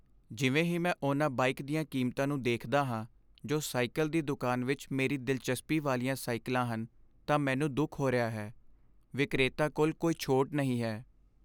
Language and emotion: Punjabi, sad